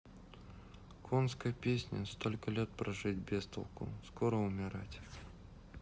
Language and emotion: Russian, sad